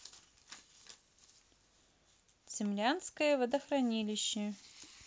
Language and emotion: Russian, neutral